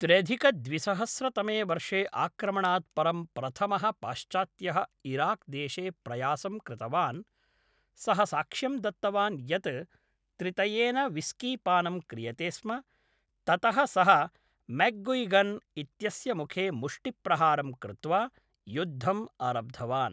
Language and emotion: Sanskrit, neutral